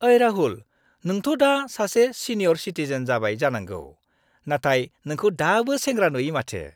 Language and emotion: Bodo, happy